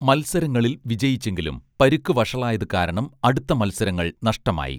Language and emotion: Malayalam, neutral